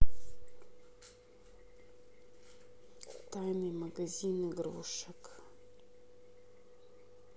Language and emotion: Russian, sad